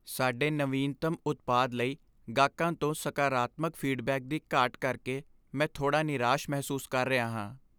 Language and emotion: Punjabi, sad